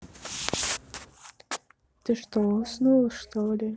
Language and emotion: Russian, sad